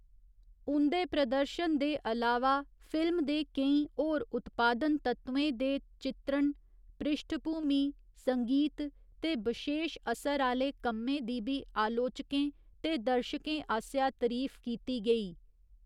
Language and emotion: Dogri, neutral